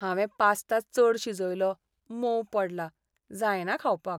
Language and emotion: Goan Konkani, sad